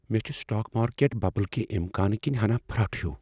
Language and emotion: Kashmiri, fearful